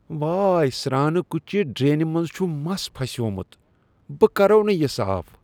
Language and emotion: Kashmiri, disgusted